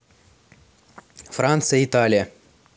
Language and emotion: Russian, neutral